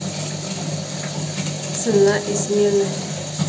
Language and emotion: Russian, neutral